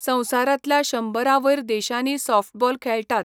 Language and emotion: Goan Konkani, neutral